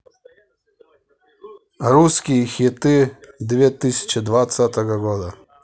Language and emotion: Russian, neutral